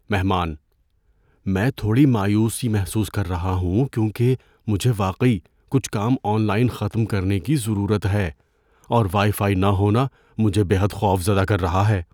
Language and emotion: Urdu, fearful